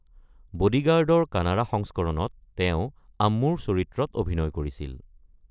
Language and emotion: Assamese, neutral